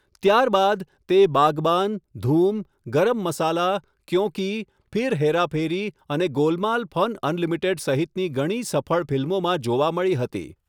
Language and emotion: Gujarati, neutral